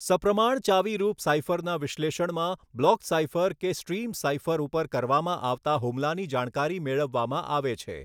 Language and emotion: Gujarati, neutral